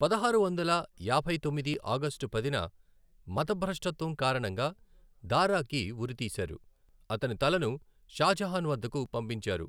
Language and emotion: Telugu, neutral